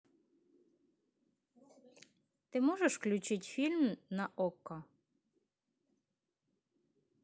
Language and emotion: Russian, neutral